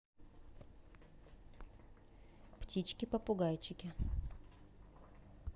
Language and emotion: Russian, neutral